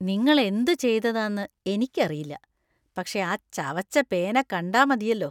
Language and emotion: Malayalam, disgusted